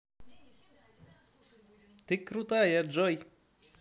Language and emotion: Russian, positive